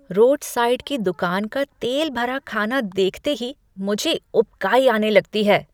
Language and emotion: Hindi, disgusted